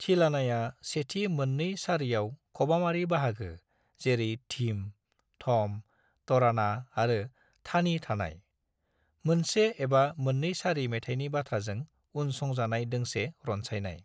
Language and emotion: Bodo, neutral